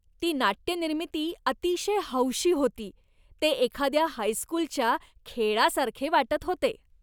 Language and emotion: Marathi, disgusted